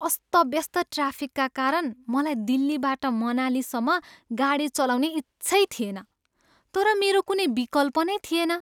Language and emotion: Nepali, disgusted